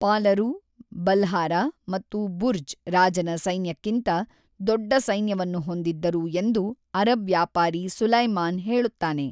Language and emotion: Kannada, neutral